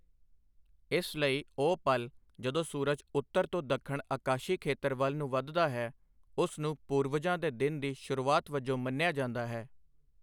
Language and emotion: Punjabi, neutral